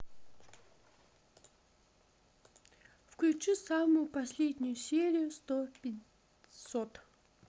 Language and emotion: Russian, neutral